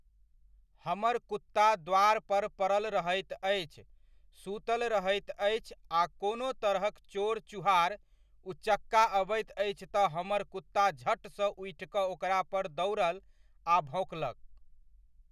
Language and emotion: Maithili, neutral